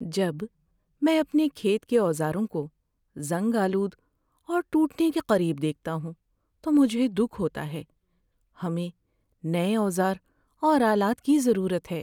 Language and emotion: Urdu, sad